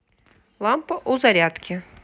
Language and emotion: Russian, neutral